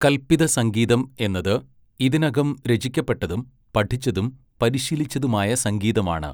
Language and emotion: Malayalam, neutral